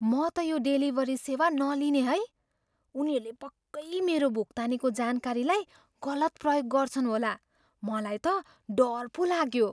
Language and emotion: Nepali, fearful